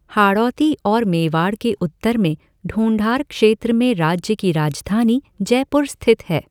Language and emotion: Hindi, neutral